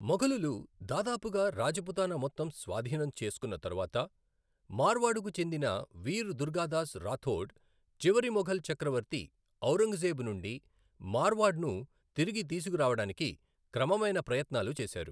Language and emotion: Telugu, neutral